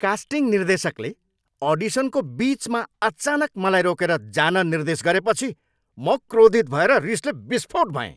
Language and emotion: Nepali, angry